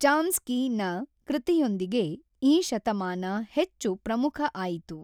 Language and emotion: Kannada, neutral